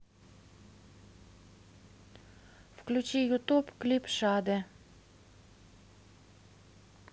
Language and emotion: Russian, neutral